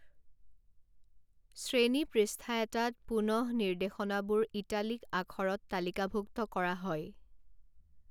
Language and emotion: Assamese, neutral